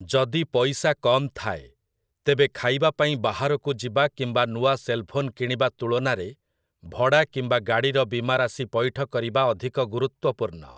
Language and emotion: Odia, neutral